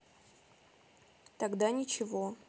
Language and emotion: Russian, neutral